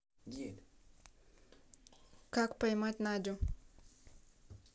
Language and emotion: Russian, neutral